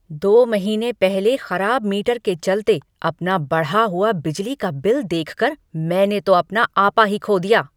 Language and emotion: Hindi, angry